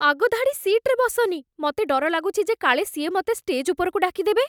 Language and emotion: Odia, fearful